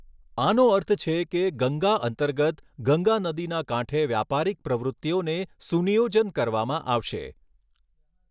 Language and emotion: Gujarati, neutral